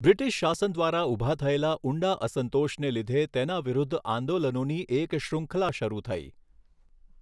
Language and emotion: Gujarati, neutral